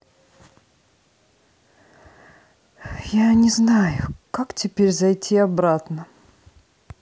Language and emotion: Russian, sad